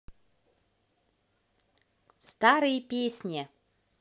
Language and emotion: Russian, positive